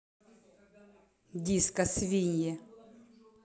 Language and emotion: Russian, angry